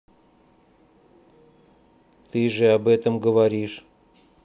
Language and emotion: Russian, neutral